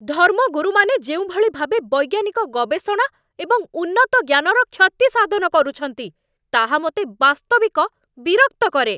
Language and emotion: Odia, angry